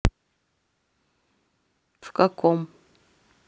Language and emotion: Russian, neutral